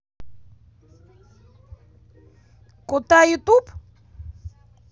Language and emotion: Russian, positive